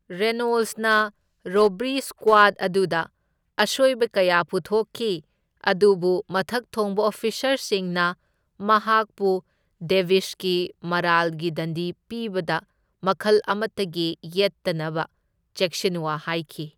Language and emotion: Manipuri, neutral